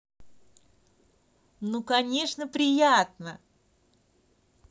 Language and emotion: Russian, positive